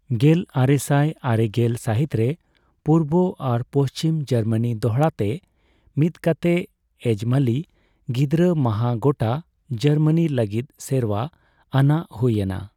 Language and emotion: Santali, neutral